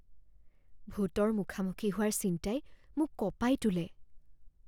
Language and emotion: Assamese, fearful